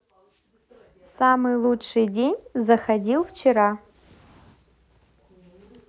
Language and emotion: Russian, positive